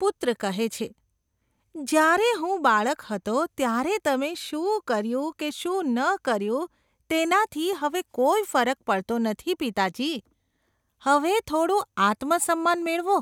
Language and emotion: Gujarati, disgusted